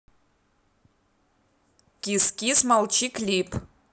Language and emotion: Russian, neutral